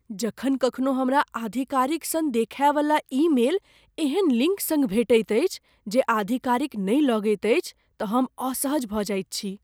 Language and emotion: Maithili, fearful